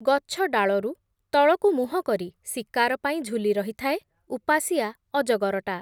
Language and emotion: Odia, neutral